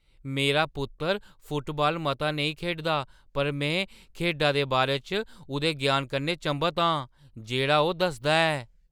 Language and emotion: Dogri, surprised